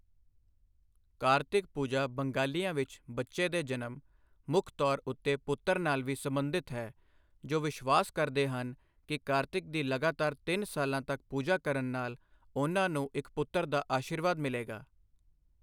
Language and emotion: Punjabi, neutral